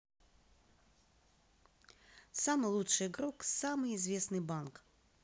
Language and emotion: Russian, positive